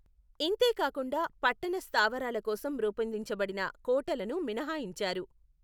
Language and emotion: Telugu, neutral